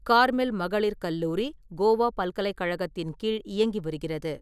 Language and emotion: Tamil, neutral